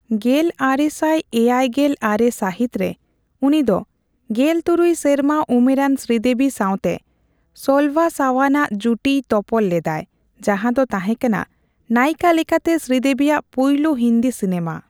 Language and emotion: Santali, neutral